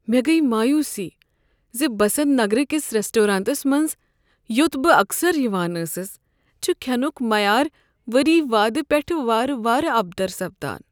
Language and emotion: Kashmiri, sad